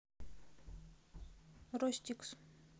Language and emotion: Russian, neutral